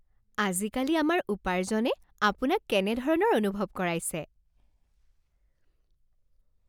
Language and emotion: Assamese, happy